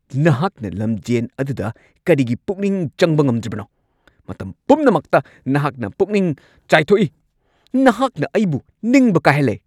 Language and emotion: Manipuri, angry